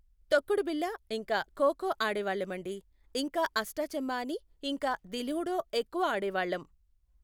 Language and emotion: Telugu, neutral